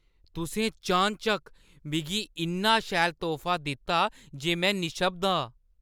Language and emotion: Dogri, surprised